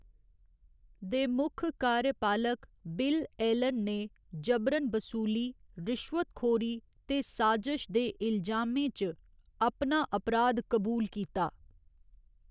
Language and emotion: Dogri, neutral